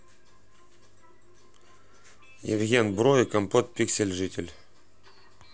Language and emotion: Russian, neutral